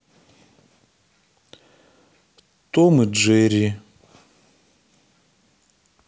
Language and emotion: Russian, neutral